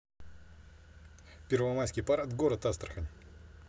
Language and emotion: Russian, neutral